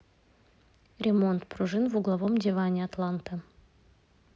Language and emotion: Russian, neutral